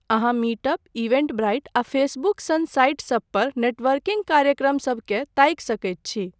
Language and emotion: Maithili, neutral